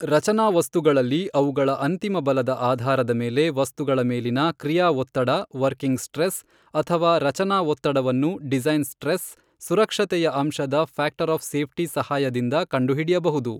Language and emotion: Kannada, neutral